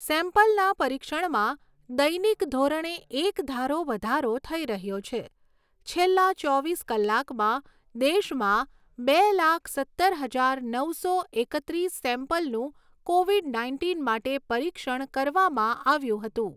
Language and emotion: Gujarati, neutral